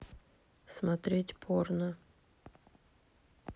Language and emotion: Russian, neutral